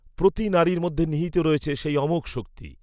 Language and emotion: Bengali, neutral